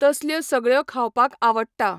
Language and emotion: Goan Konkani, neutral